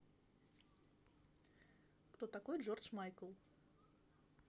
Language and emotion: Russian, neutral